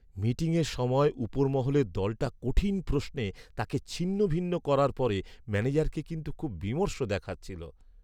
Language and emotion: Bengali, sad